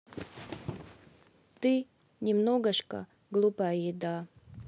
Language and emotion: Russian, neutral